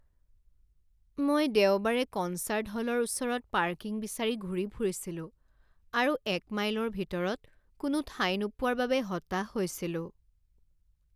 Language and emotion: Assamese, sad